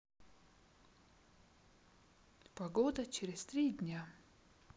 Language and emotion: Russian, sad